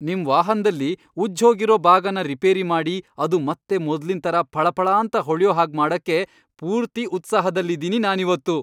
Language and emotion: Kannada, happy